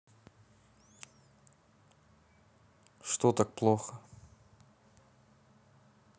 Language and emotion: Russian, neutral